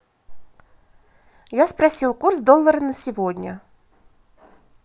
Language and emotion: Russian, positive